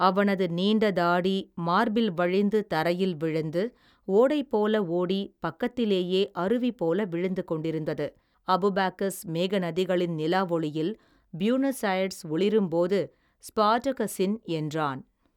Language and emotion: Tamil, neutral